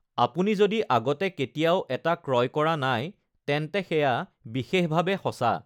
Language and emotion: Assamese, neutral